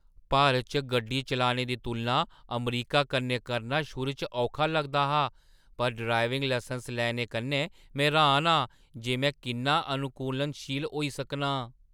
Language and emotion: Dogri, surprised